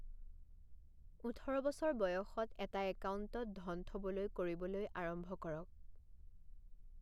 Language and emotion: Assamese, neutral